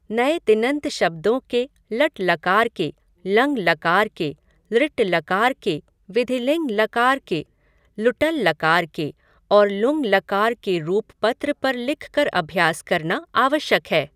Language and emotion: Hindi, neutral